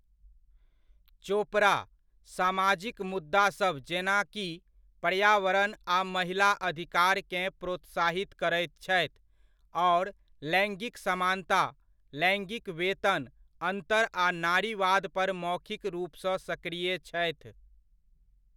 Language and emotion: Maithili, neutral